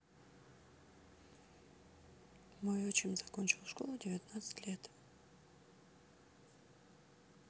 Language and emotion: Russian, neutral